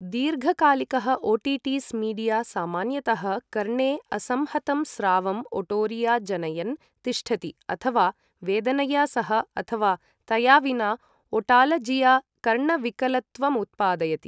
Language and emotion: Sanskrit, neutral